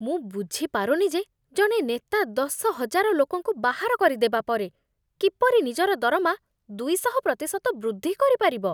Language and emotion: Odia, disgusted